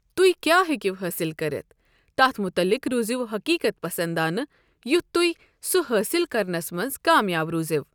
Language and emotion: Kashmiri, neutral